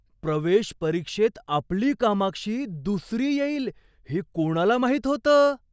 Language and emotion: Marathi, surprised